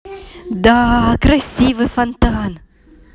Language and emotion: Russian, positive